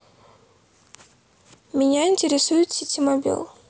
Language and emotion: Russian, neutral